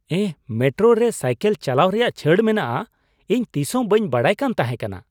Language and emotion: Santali, surprised